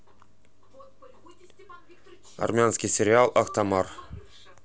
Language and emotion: Russian, neutral